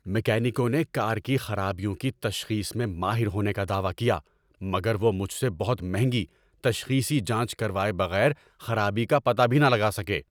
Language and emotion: Urdu, angry